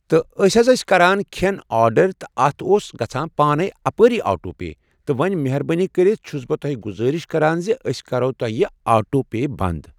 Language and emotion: Kashmiri, neutral